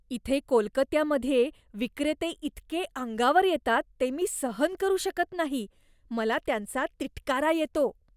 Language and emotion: Marathi, disgusted